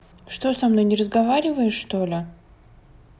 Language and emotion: Russian, neutral